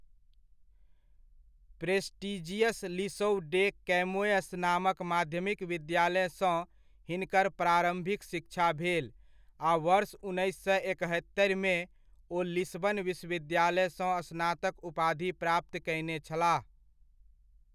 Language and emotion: Maithili, neutral